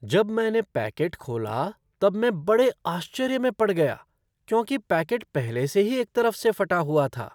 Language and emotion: Hindi, surprised